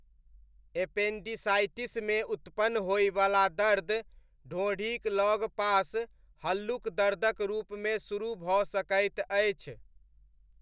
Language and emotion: Maithili, neutral